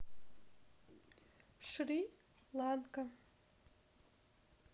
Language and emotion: Russian, neutral